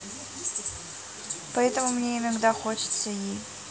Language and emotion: Russian, neutral